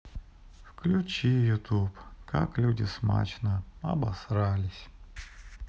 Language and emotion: Russian, sad